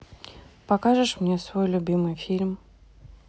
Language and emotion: Russian, neutral